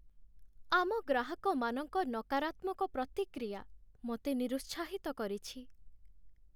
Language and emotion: Odia, sad